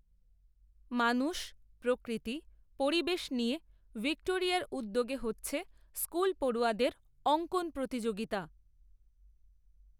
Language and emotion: Bengali, neutral